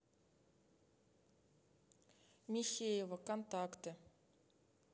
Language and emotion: Russian, neutral